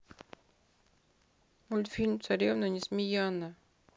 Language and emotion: Russian, sad